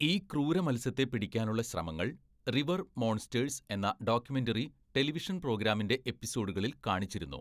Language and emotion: Malayalam, neutral